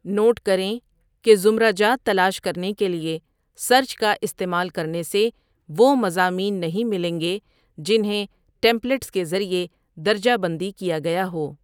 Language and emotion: Urdu, neutral